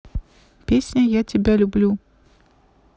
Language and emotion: Russian, neutral